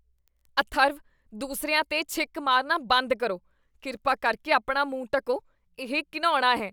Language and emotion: Punjabi, disgusted